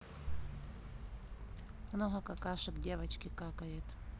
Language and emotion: Russian, neutral